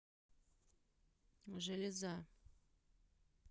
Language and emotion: Russian, neutral